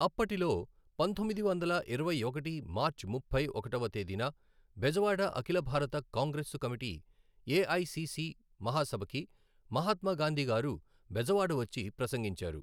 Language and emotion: Telugu, neutral